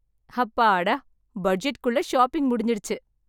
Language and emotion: Tamil, happy